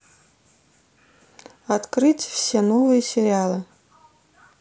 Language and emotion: Russian, neutral